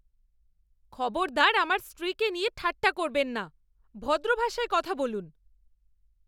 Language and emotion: Bengali, angry